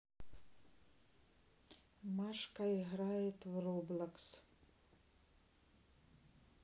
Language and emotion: Russian, neutral